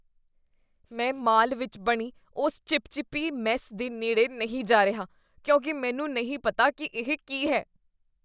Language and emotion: Punjabi, disgusted